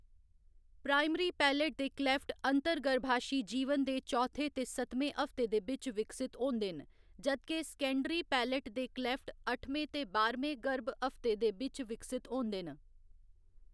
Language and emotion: Dogri, neutral